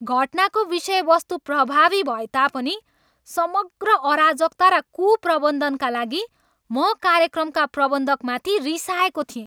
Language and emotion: Nepali, angry